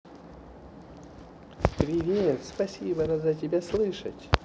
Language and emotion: Russian, positive